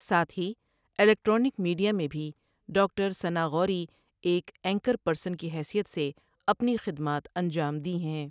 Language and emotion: Urdu, neutral